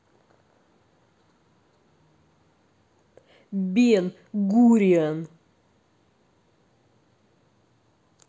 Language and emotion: Russian, angry